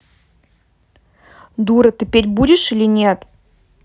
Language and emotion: Russian, angry